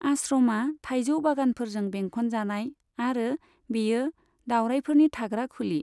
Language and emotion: Bodo, neutral